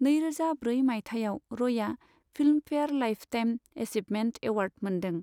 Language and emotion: Bodo, neutral